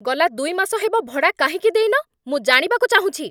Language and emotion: Odia, angry